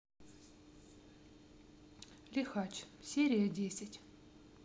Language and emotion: Russian, neutral